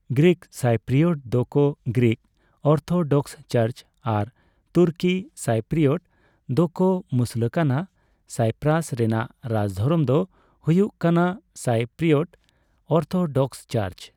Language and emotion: Santali, neutral